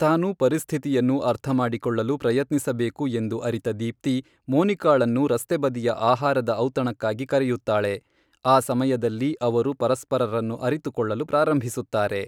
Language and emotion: Kannada, neutral